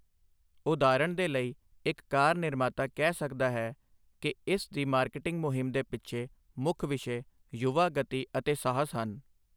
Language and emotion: Punjabi, neutral